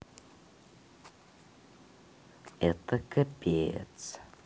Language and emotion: Russian, neutral